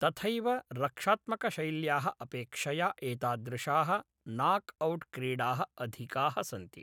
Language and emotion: Sanskrit, neutral